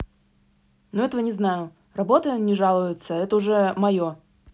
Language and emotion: Russian, angry